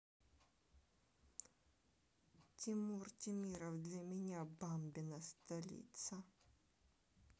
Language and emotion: Russian, neutral